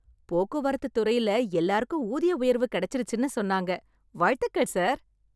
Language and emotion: Tamil, happy